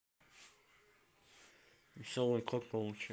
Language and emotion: Russian, neutral